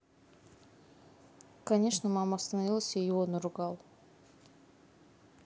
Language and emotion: Russian, neutral